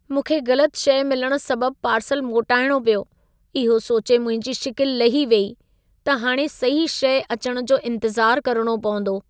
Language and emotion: Sindhi, sad